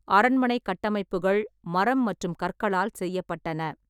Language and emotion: Tamil, neutral